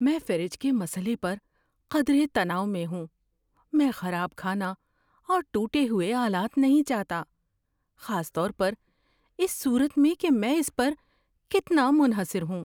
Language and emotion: Urdu, fearful